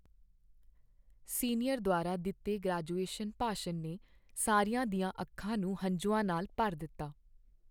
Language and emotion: Punjabi, sad